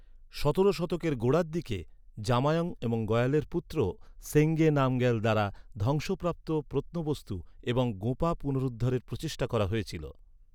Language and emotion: Bengali, neutral